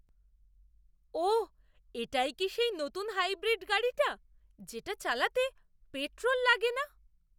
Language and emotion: Bengali, surprised